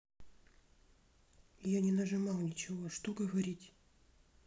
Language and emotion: Russian, neutral